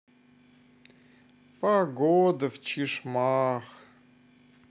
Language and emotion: Russian, sad